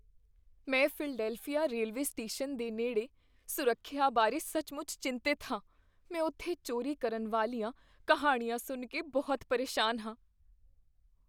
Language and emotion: Punjabi, fearful